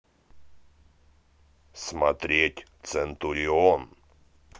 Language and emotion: Russian, positive